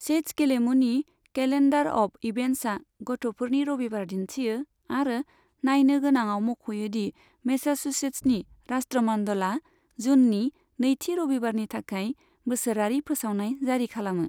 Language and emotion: Bodo, neutral